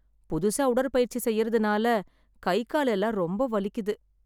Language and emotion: Tamil, sad